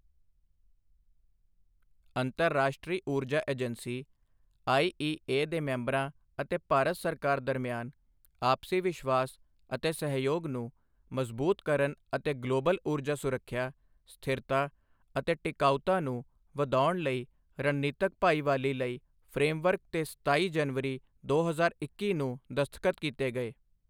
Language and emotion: Punjabi, neutral